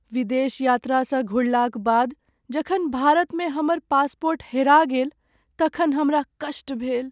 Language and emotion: Maithili, sad